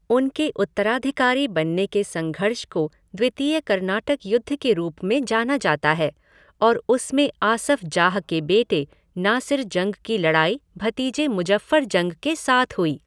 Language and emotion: Hindi, neutral